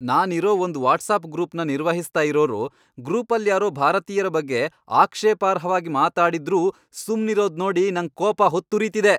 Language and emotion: Kannada, angry